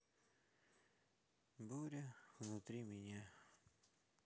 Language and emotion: Russian, sad